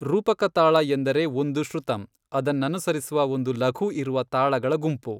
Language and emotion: Kannada, neutral